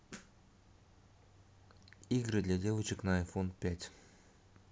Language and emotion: Russian, neutral